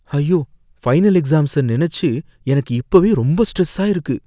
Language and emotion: Tamil, fearful